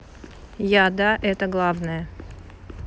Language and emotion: Russian, neutral